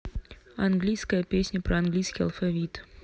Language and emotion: Russian, neutral